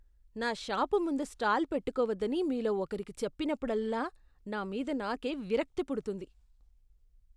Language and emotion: Telugu, disgusted